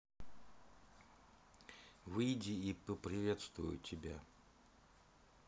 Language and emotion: Russian, neutral